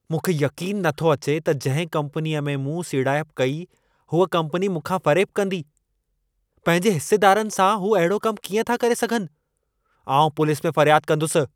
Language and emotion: Sindhi, angry